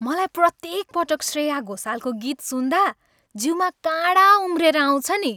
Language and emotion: Nepali, happy